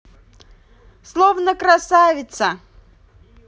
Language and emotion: Russian, positive